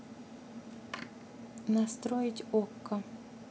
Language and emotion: Russian, neutral